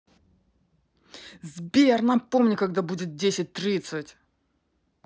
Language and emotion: Russian, angry